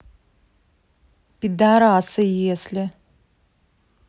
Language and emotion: Russian, angry